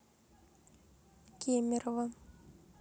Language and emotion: Russian, neutral